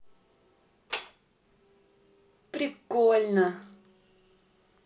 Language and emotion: Russian, positive